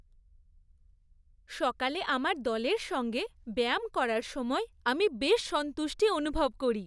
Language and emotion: Bengali, happy